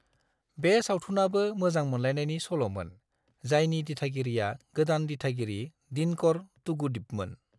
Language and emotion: Bodo, neutral